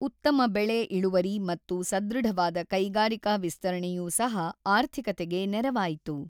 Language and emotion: Kannada, neutral